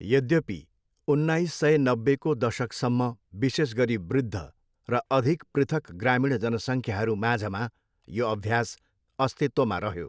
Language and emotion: Nepali, neutral